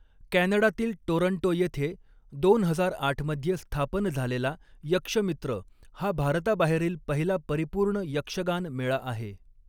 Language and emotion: Marathi, neutral